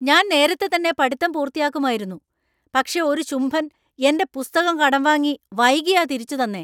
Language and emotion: Malayalam, angry